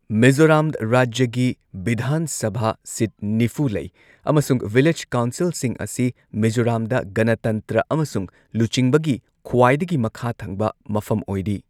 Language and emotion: Manipuri, neutral